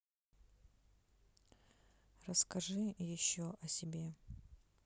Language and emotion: Russian, neutral